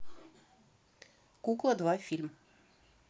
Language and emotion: Russian, neutral